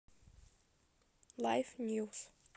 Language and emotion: Russian, neutral